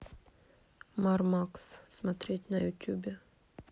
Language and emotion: Russian, neutral